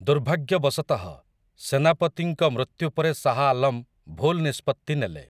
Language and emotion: Odia, neutral